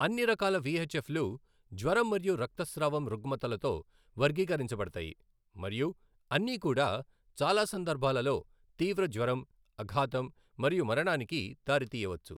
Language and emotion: Telugu, neutral